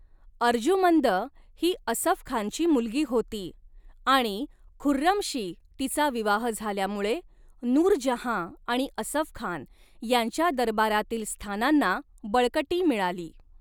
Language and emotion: Marathi, neutral